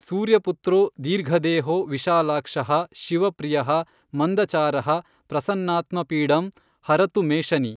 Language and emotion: Kannada, neutral